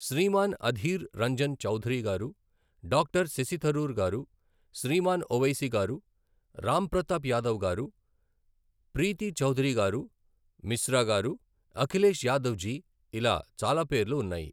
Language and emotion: Telugu, neutral